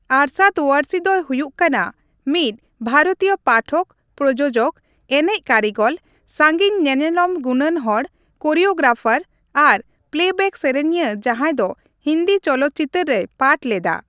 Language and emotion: Santali, neutral